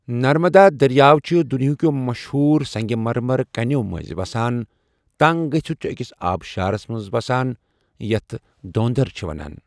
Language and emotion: Kashmiri, neutral